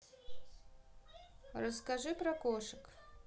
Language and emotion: Russian, neutral